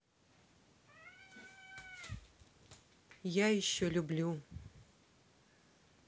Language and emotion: Russian, neutral